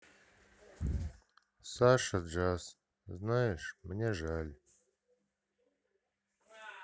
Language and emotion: Russian, sad